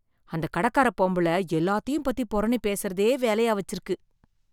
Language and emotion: Tamil, disgusted